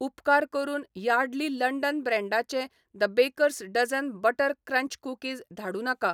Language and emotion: Goan Konkani, neutral